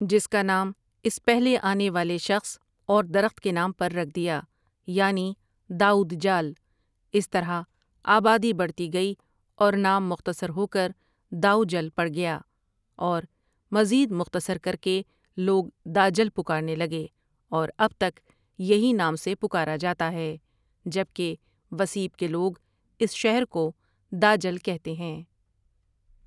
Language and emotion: Urdu, neutral